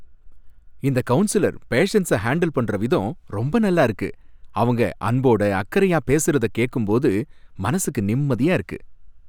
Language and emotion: Tamil, happy